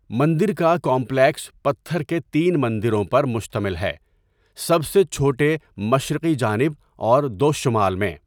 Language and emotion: Urdu, neutral